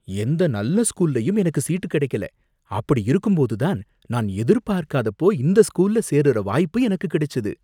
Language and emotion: Tamil, surprised